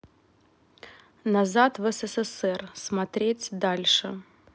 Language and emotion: Russian, neutral